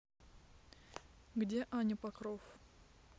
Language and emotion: Russian, neutral